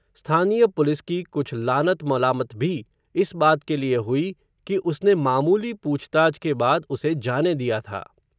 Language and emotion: Hindi, neutral